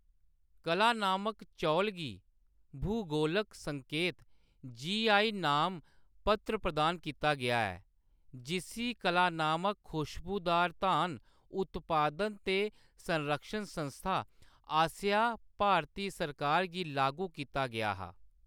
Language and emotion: Dogri, neutral